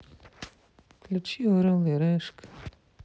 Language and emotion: Russian, sad